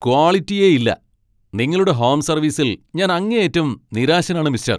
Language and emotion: Malayalam, angry